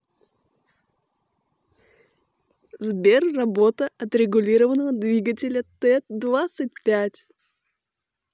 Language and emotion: Russian, positive